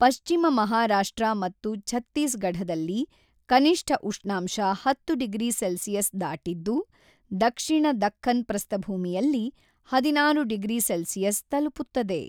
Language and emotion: Kannada, neutral